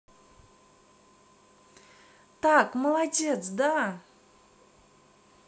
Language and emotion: Russian, positive